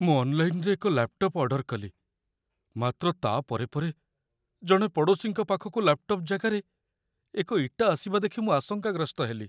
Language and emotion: Odia, fearful